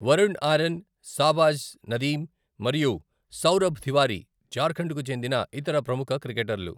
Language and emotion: Telugu, neutral